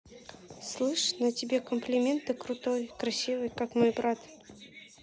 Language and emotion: Russian, neutral